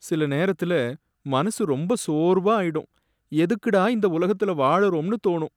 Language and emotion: Tamil, sad